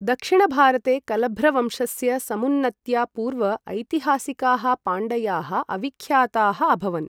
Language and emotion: Sanskrit, neutral